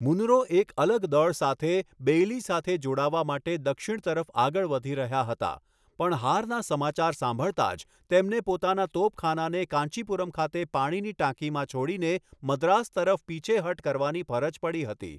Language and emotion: Gujarati, neutral